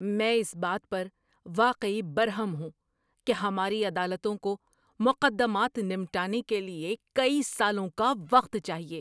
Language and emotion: Urdu, angry